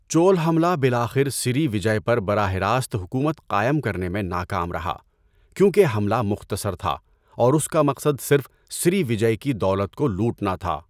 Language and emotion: Urdu, neutral